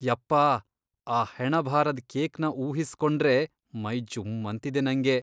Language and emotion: Kannada, disgusted